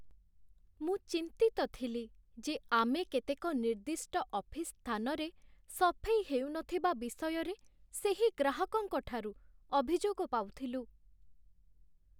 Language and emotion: Odia, sad